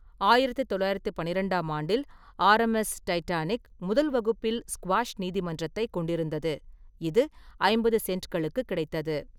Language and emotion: Tamil, neutral